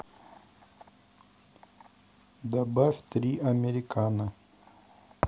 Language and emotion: Russian, neutral